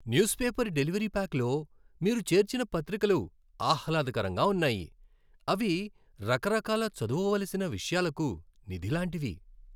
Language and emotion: Telugu, happy